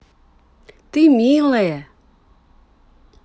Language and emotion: Russian, positive